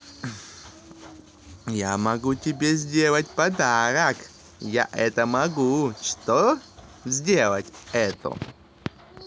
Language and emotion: Russian, positive